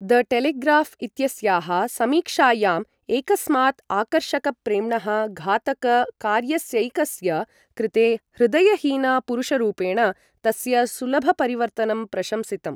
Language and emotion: Sanskrit, neutral